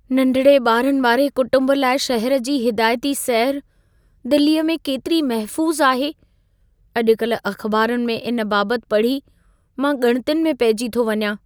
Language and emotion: Sindhi, fearful